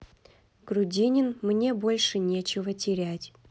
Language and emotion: Russian, neutral